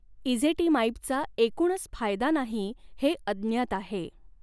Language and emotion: Marathi, neutral